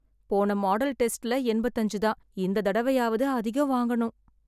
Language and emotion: Tamil, sad